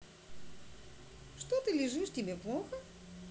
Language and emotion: Russian, positive